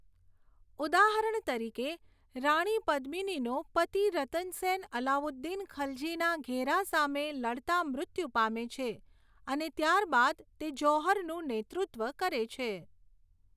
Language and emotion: Gujarati, neutral